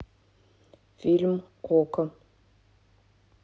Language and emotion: Russian, neutral